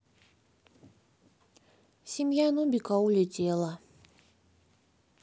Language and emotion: Russian, sad